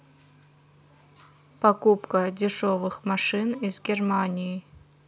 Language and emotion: Russian, neutral